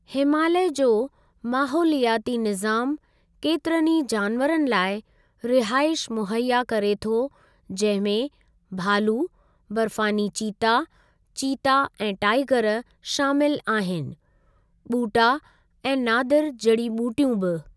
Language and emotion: Sindhi, neutral